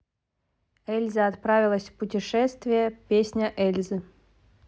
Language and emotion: Russian, neutral